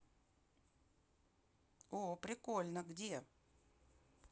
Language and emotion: Russian, positive